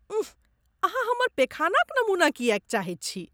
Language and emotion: Maithili, disgusted